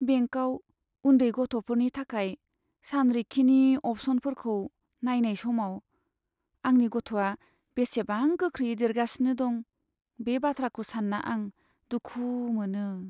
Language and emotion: Bodo, sad